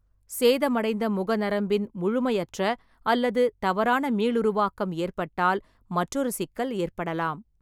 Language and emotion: Tamil, neutral